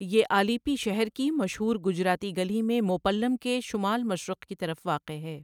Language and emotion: Urdu, neutral